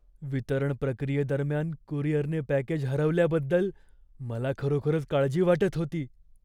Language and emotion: Marathi, fearful